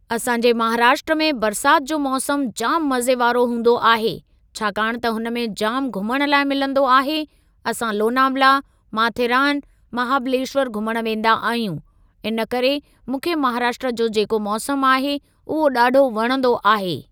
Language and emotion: Sindhi, neutral